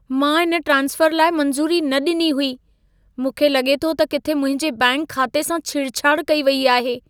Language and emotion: Sindhi, fearful